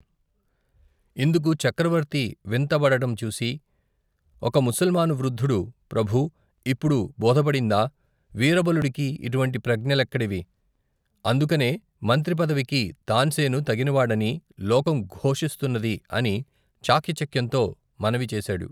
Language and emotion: Telugu, neutral